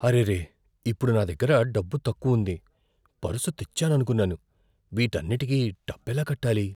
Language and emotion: Telugu, fearful